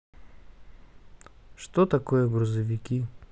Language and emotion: Russian, neutral